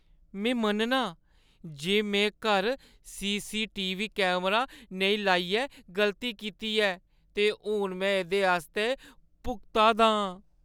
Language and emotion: Dogri, sad